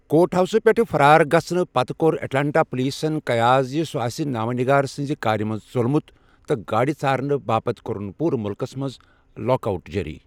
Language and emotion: Kashmiri, neutral